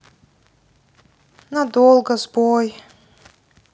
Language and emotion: Russian, sad